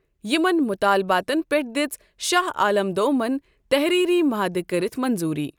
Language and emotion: Kashmiri, neutral